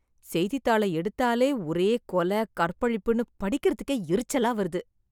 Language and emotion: Tamil, disgusted